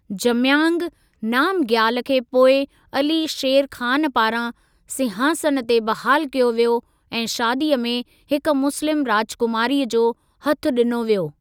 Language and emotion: Sindhi, neutral